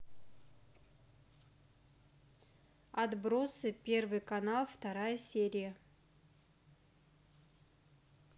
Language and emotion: Russian, neutral